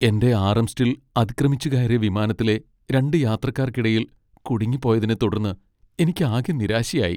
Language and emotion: Malayalam, sad